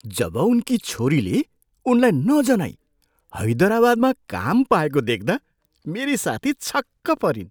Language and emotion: Nepali, surprised